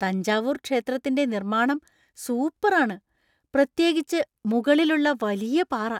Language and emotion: Malayalam, surprised